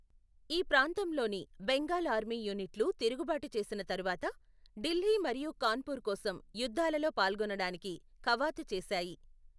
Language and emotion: Telugu, neutral